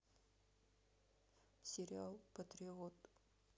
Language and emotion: Russian, sad